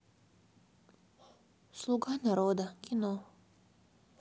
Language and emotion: Russian, sad